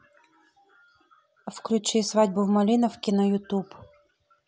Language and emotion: Russian, neutral